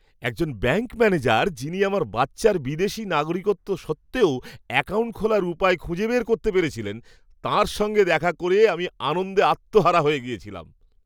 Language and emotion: Bengali, happy